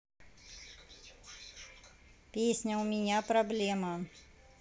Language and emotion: Russian, neutral